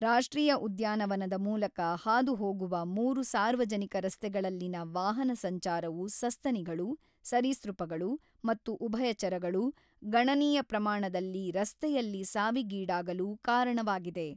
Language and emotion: Kannada, neutral